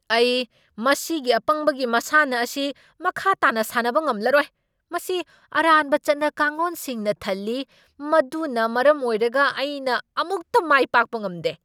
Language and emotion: Manipuri, angry